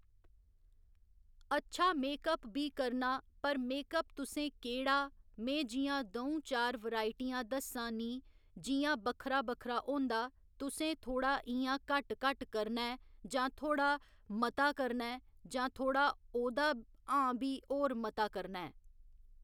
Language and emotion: Dogri, neutral